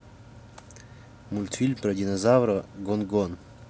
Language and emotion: Russian, neutral